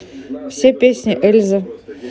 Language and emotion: Russian, neutral